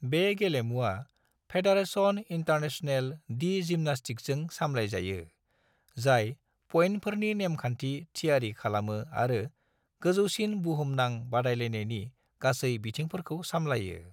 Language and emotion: Bodo, neutral